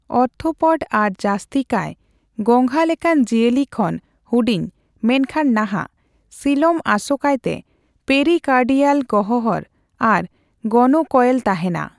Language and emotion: Santali, neutral